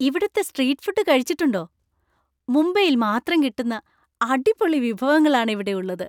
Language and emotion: Malayalam, happy